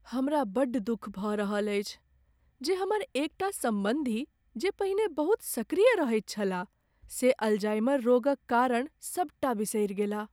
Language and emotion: Maithili, sad